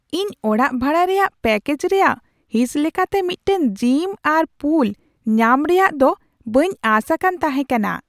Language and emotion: Santali, surprised